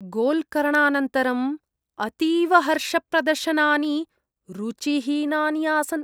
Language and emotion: Sanskrit, disgusted